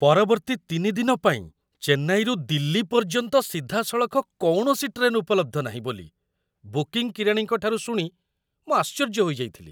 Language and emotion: Odia, surprised